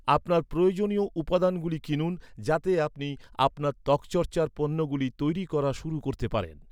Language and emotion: Bengali, neutral